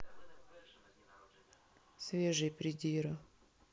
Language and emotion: Russian, neutral